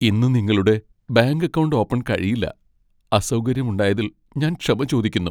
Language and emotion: Malayalam, sad